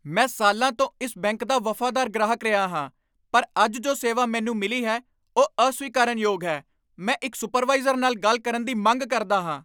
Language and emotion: Punjabi, angry